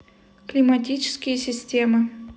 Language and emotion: Russian, neutral